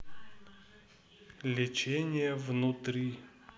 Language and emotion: Russian, neutral